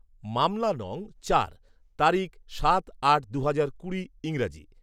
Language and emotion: Bengali, neutral